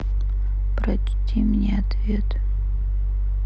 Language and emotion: Russian, sad